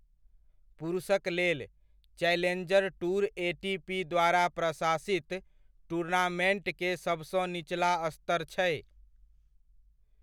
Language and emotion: Maithili, neutral